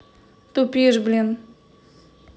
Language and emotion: Russian, angry